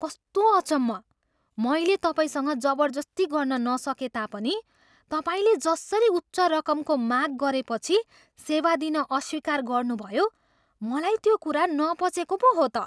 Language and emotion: Nepali, surprised